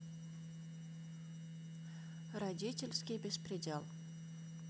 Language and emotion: Russian, neutral